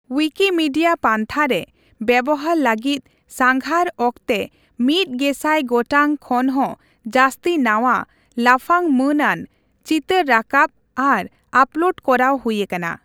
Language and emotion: Santali, neutral